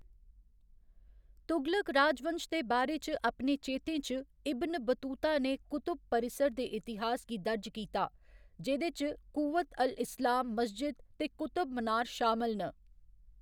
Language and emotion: Dogri, neutral